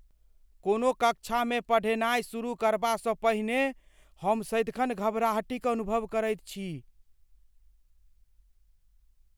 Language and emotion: Maithili, fearful